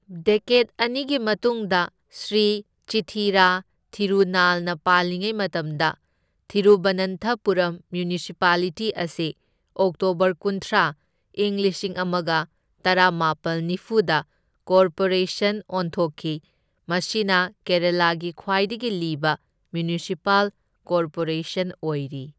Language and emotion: Manipuri, neutral